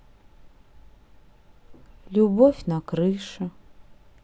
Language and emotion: Russian, sad